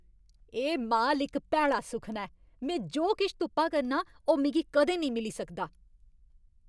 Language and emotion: Dogri, angry